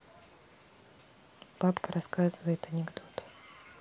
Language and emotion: Russian, neutral